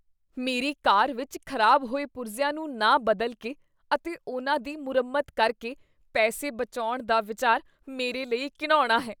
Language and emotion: Punjabi, disgusted